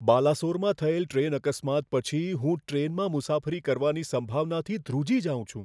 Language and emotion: Gujarati, fearful